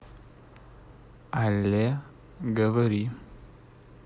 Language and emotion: Russian, neutral